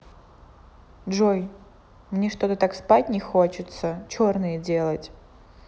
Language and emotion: Russian, neutral